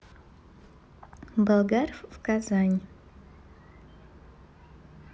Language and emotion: Russian, neutral